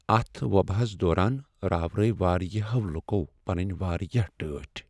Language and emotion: Kashmiri, sad